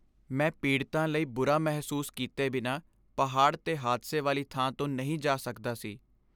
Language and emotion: Punjabi, sad